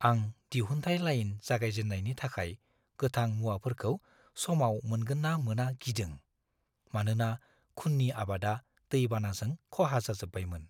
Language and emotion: Bodo, fearful